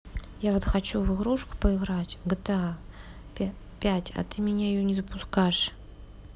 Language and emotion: Russian, neutral